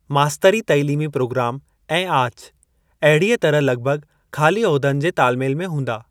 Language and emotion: Sindhi, neutral